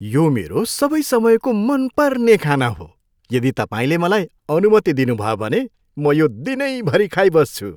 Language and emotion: Nepali, happy